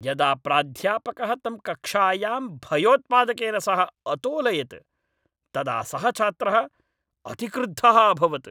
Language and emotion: Sanskrit, angry